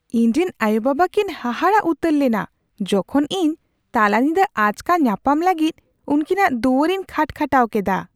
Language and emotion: Santali, surprised